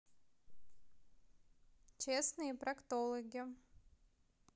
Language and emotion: Russian, neutral